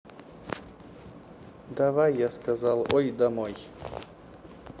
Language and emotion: Russian, neutral